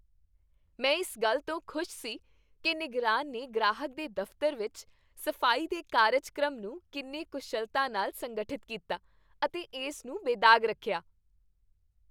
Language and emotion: Punjabi, happy